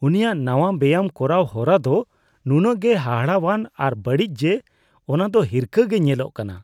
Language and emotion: Santali, disgusted